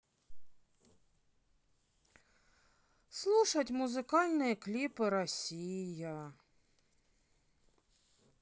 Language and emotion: Russian, sad